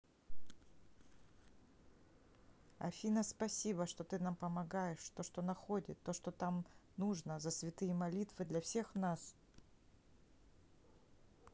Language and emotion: Russian, neutral